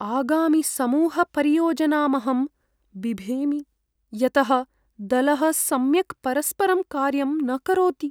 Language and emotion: Sanskrit, fearful